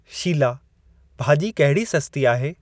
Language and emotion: Sindhi, neutral